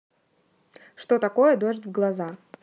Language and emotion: Russian, neutral